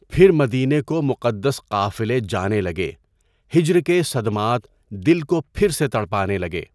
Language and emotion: Urdu, neutral